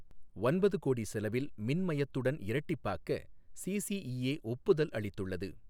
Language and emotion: Tamil, neutral